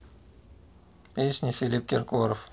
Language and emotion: Russian, neutral